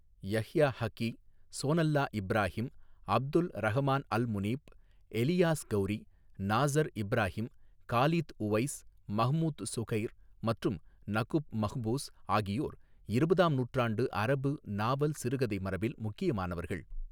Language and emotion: Tamil, neutral